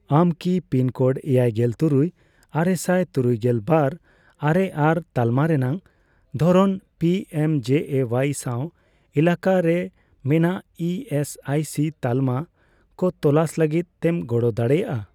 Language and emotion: Santali, neutral